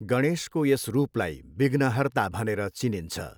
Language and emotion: Nepali, neutral